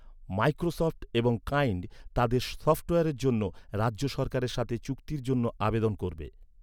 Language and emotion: Bengali, neutral